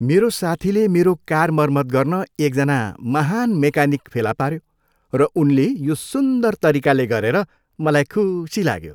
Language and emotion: Nepali, happy